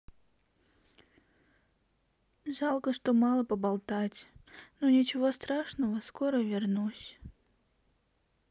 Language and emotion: Russian, sad